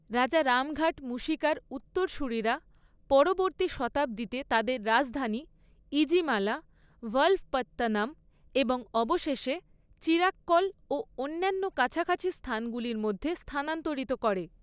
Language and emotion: Bengali, neutral